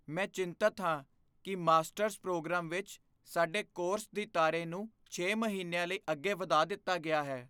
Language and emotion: Punjabi, fearful